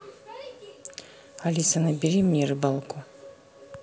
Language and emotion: Russian, neutral